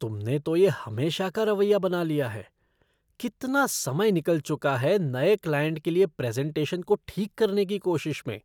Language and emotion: Hindi, disgusted